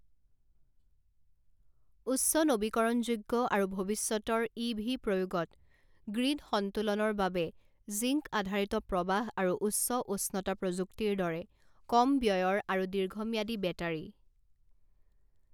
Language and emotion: Assamese, neutral